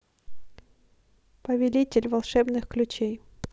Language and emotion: Russian, neutral